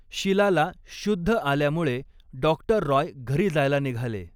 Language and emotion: Marathi, neutral